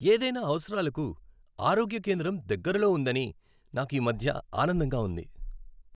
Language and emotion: Telugu, happy